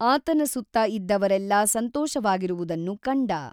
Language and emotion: Kannada, neutral